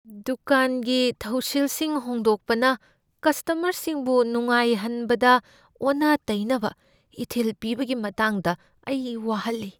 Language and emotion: Manipuri, fearful